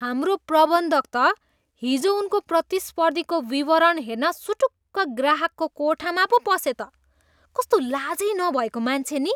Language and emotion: Nepali, disgusted